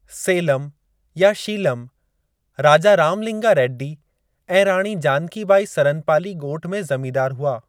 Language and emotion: Sindhi, neutral